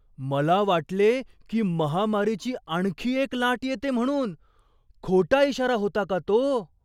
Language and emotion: Marathi, surprised